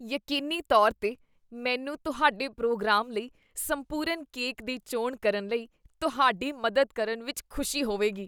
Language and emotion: Punjabi, disgusted